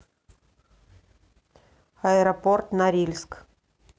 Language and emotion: Russian, neutral